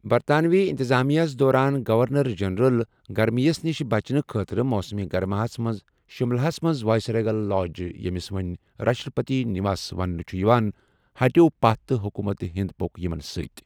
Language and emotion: Kashmiri, neutral